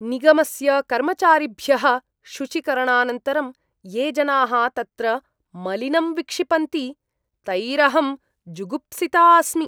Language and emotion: Sanskrit, disgusted